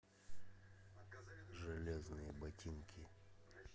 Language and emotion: Russian, neutral